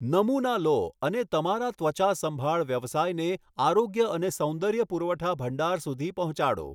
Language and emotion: Gujarati, neutral